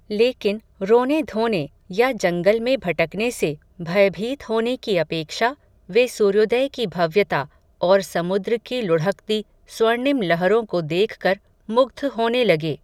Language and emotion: Hindi, neutral